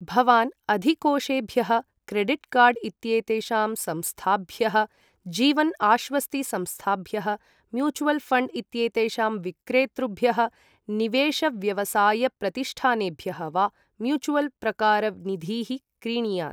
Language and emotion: Sanskrit, neutral